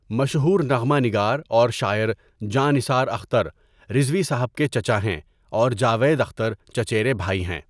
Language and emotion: Urdu, neutral